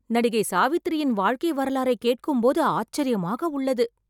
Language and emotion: Tamil, surprised